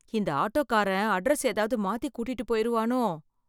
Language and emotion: Tamil, fearful